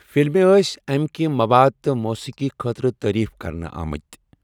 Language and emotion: Kashmiri, neutral